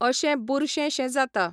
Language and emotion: Goan Konkani, neutral